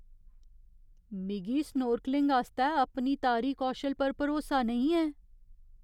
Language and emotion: Dogri, fearful